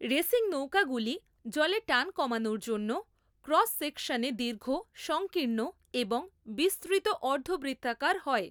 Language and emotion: Bengali, neutral